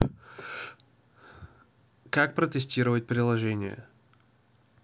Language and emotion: Russian, neutral